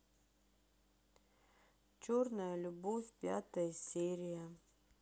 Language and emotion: Russian, sad